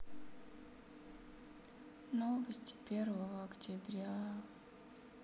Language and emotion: Russian, sad